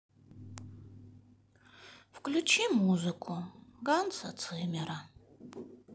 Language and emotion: Russian, sad